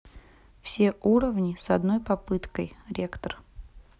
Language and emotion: Russian, neutral